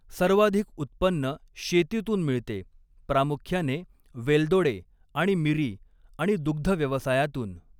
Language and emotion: Marathi, neutral